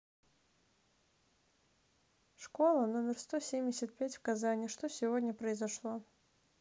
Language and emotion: Russian, neutral